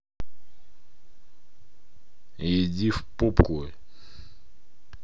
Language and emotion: Russian, angry